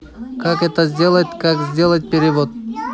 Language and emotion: Russian, neutral